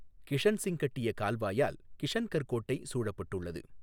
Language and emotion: Tamil, neutral